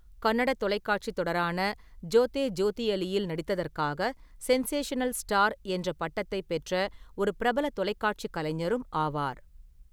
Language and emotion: Tamil, neutral